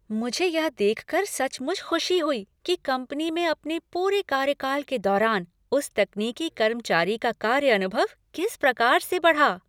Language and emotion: Hindi, happy